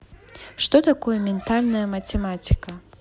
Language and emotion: Russian, neutral